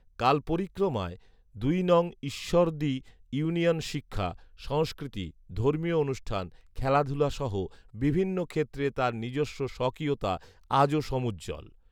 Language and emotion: Bengali, neutral